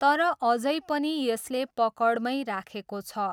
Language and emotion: Nepali, neutral